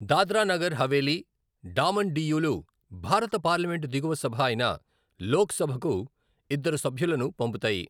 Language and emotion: Telugu, neutral